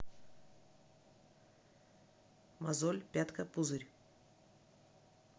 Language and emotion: Russian, neutral